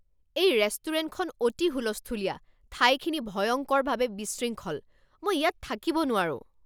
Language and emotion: Assamese, angry